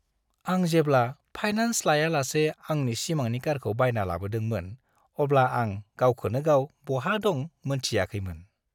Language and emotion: Bodo, happy